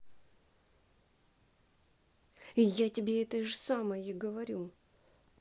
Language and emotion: Russian, angry